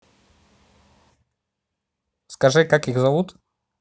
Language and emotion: Russian, neutral